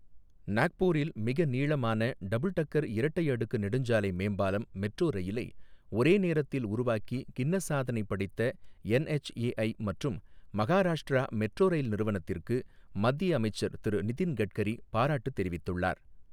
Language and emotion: Tamil, neutral